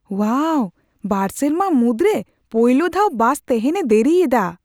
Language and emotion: Santali, surprised